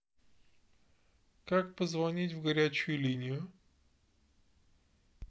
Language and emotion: Russian, neutral